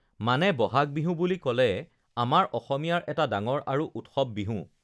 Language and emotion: Assamese, neutral